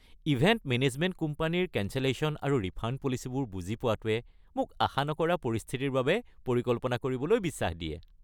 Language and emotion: Assamese, happy